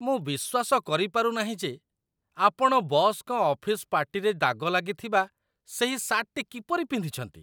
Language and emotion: Odia, disgusted